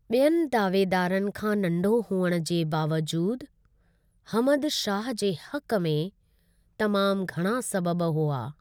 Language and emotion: Sindhi, neutral